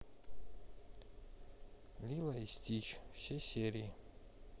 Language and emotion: Russian, neutral